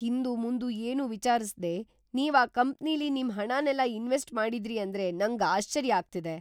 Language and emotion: Kannada, surprised